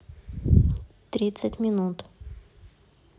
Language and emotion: Russian, neutral